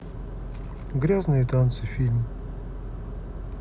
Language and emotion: Russian, neutral